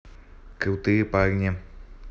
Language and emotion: Russian, neutral